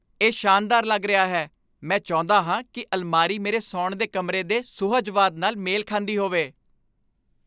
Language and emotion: Punjabi, happy